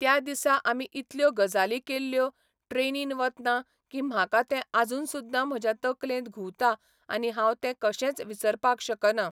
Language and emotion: Goan Konkani, neutral